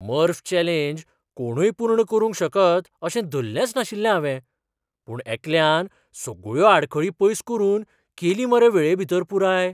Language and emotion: Goan Konkani, surprised